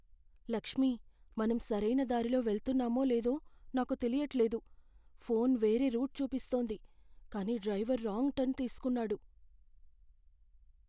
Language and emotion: Telugu, fearful